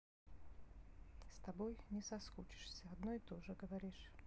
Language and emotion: Russian, sad